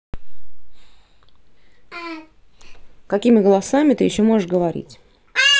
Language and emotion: Russian, neutral